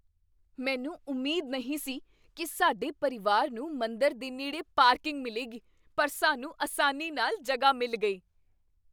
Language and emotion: Punjabi, surprised